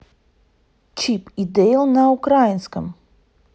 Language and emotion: Russian, neutral